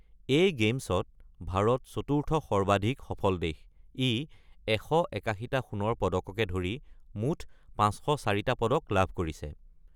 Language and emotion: Assamese, neutral